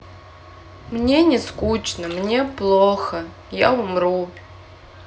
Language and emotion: Russian, sad